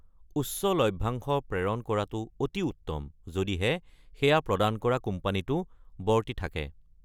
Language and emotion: Assamese, neutral